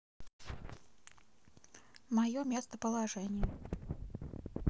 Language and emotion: Russian, neutral